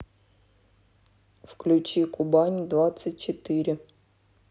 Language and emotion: Russian, neutral